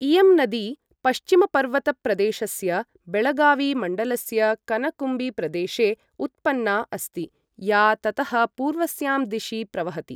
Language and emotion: Sanskrit, neutral